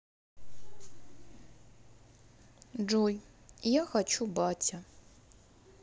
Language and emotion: Russian, sad